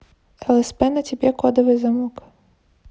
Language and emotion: Russian, neutral